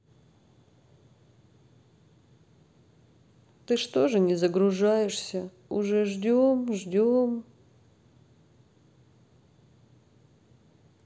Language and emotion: Russian, sad